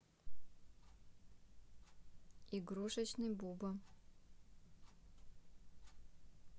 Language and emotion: Russian, neutral